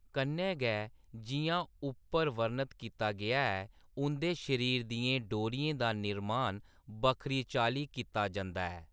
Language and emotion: Dogri, neutral